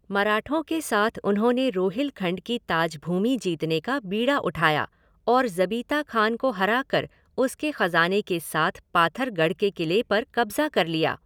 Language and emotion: Hindi, neutral